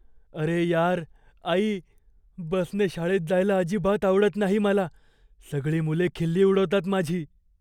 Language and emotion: Marathi, fearful